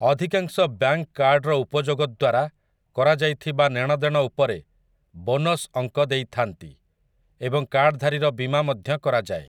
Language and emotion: Odia, neutral